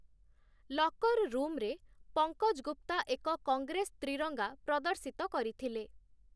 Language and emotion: Odia, neutral